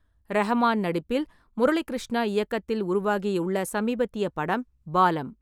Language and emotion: Tamil, neutral